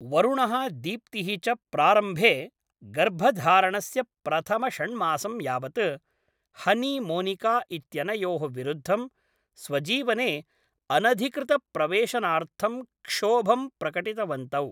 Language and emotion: Sanskrit, neutral